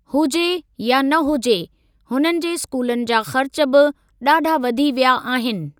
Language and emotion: Sindhi, neutral